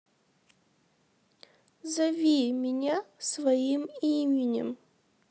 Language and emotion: Russian, sad